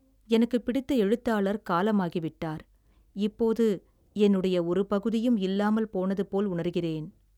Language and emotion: Tamil, sad